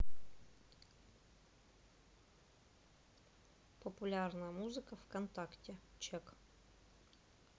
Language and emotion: Russian, neutral